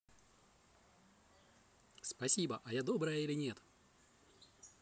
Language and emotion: Russian, positive